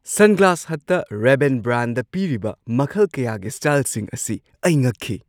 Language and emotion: Manipuri, surprised